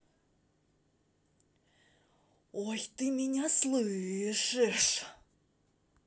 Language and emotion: Russian, angry